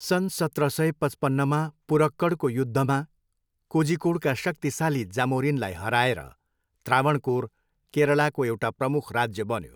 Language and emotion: Nepali, neutral